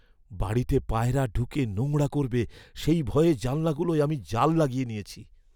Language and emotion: Bengali, fearful